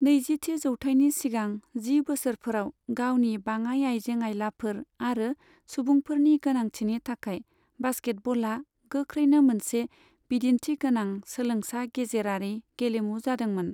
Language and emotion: Bodo, neutral